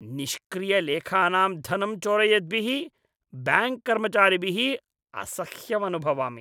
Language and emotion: Sanskrit, disgusted